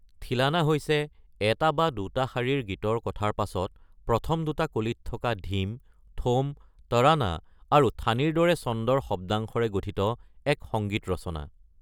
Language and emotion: Assamese, neutral